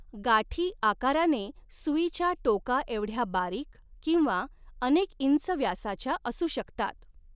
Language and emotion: Marathi, neutral